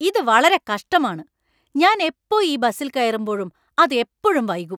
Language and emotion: Malayalam, angry